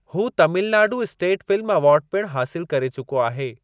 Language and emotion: Sindhi, neutral